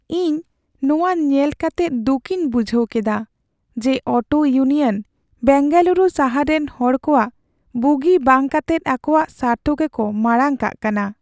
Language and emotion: Santali, sad